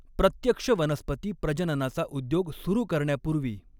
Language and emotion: Marathi, neutral